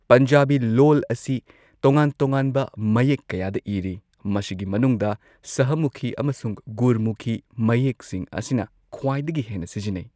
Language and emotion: Manipuri, neutral